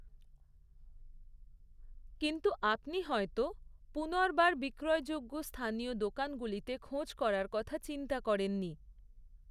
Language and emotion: Bengali, neutral